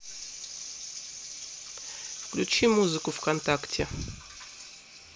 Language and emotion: Russian, neutral